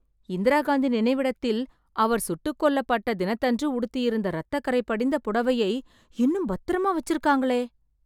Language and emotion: Tamil, surprised